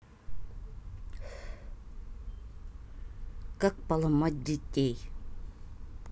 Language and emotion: Russian, angry